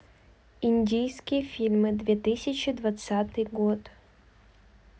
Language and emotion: Russian, neutral